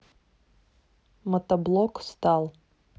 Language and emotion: Russian, neutral